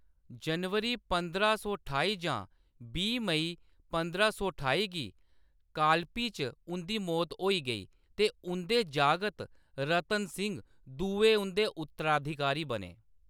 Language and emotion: Dogri, neutral